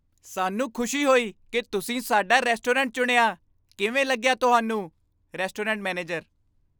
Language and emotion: Punjabi, happy